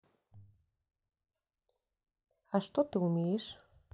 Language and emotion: Russian, neutral